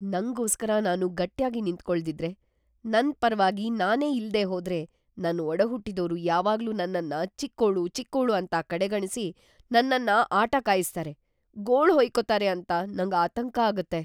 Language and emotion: Kannada, fearful